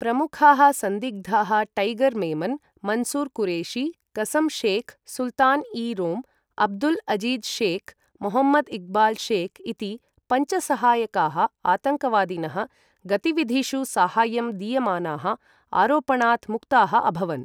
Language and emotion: Sanskrit, neutral